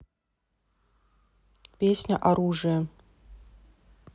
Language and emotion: Russian, neutral